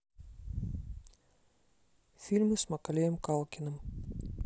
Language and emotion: Russian, neutral